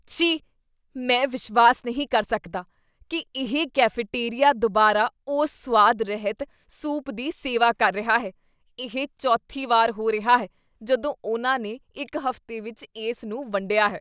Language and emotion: Punjabi, disgusted